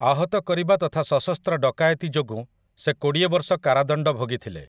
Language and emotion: Odia, neutral